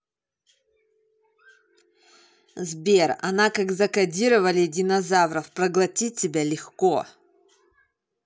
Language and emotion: Russian, angry